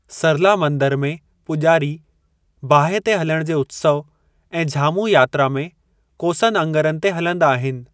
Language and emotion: Sindhi, neutral